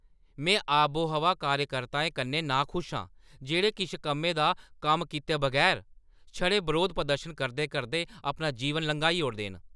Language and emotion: Dogri, angry